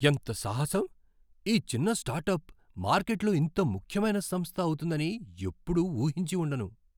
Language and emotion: Telugu, surprised